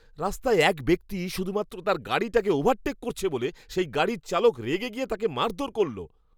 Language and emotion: Bengali, angry